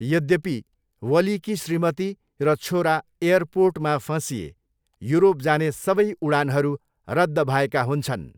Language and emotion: Nepali, neutral